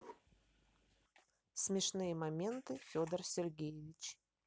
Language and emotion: Russian, neutral